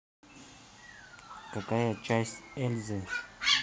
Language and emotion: Russian, neutral